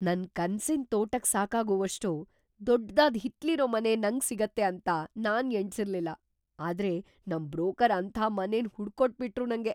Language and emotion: Kannada, surprised